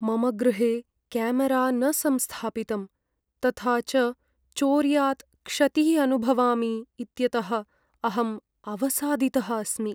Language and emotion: Sanskrit, sad